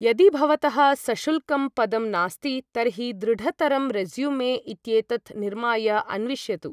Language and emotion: Sanskrit, neutral